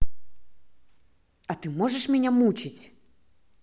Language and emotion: Russian, angry